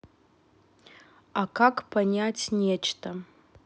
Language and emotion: Russian, neutral